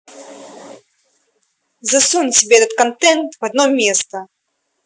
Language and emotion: Russian, angry